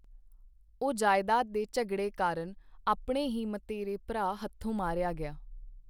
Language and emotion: Punjabi, neutral